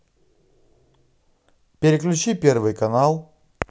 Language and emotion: Russian, positive